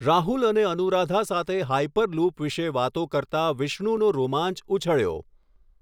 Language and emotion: Gujarati, neutral